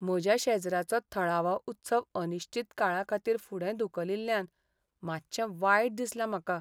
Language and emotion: Goan Konkani, sad